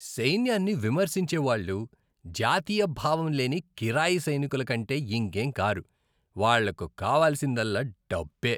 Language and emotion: Telugu, disgusted